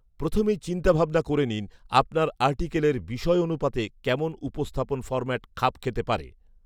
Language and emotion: Bengali, neutral